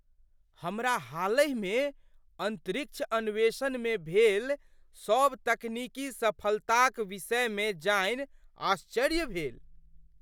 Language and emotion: Maithili, surprised